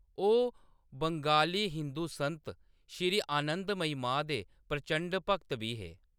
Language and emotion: Dogri, neutral